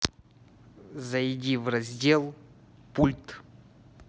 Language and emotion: Russian, neutral